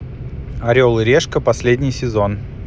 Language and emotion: Russian, neutral